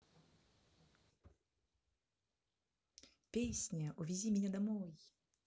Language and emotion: Russian, positive